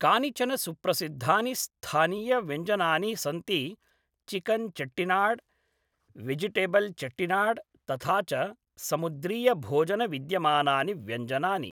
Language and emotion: Sanskrit, neutral